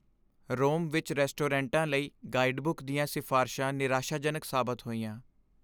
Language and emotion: Punjabi, sad